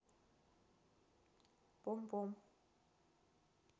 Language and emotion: Russian, neutral